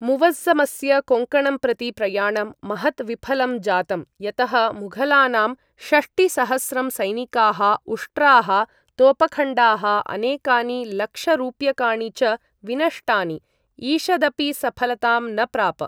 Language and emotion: Sanskrit, neutral